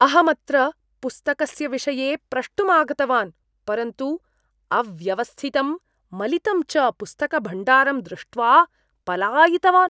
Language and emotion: Sanskrit, disgusted